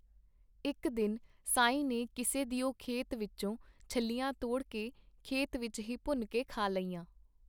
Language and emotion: Punjabi, neutral